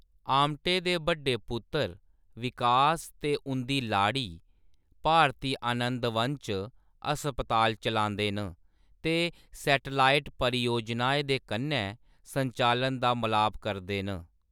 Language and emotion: Dogri, neutral